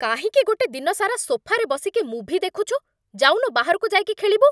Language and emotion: Odia, angry